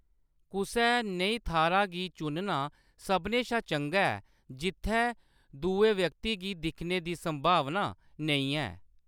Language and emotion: Dogri, neutral